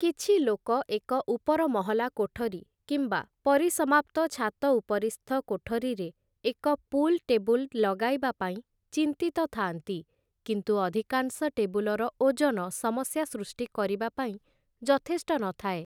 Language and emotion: Odia, neutral